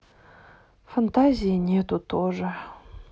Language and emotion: Russian, sad